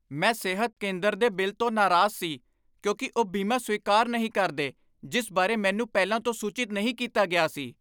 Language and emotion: Punjabi, angry